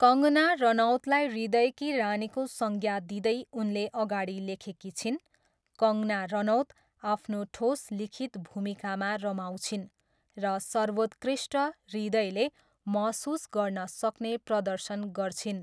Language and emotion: Nepali, neutral